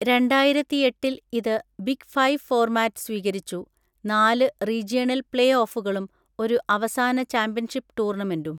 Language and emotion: Malayalam, neutral